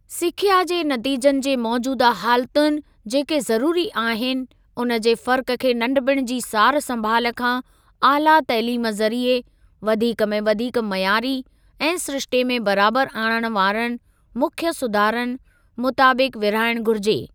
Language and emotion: Sindhi, neutral